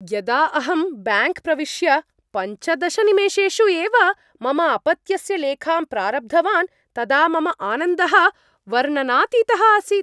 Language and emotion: Sanskrit, happy